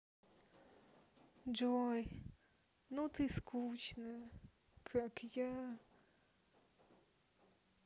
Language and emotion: Russian, sad